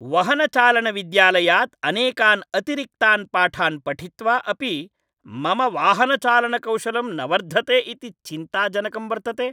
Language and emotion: Sanskrit, angry